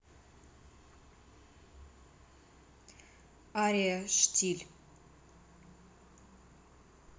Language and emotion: Russian, neutral